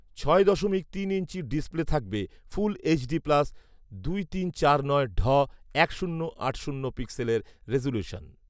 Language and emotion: Bengali, neutral